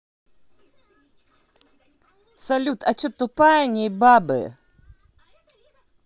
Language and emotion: Russian, angry